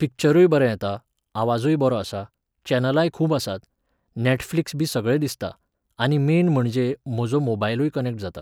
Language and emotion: Goan Konkani, neutral